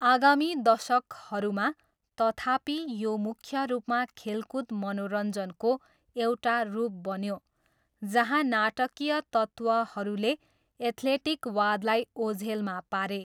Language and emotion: Nepali, neutral